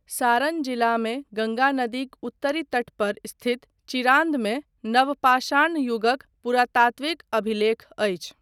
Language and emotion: Maithili, neutral